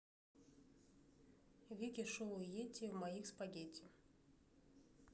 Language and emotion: Russian, neutral